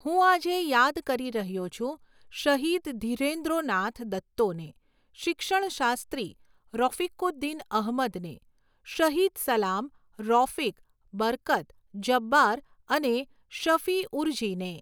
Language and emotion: Gujarati, neutral